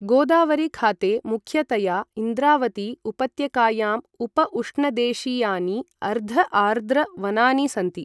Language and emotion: Sanskrit, neutral